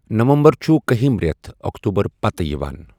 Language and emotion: Kashmiri, neutral